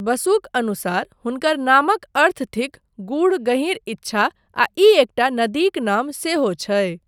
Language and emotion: Maithili, neutral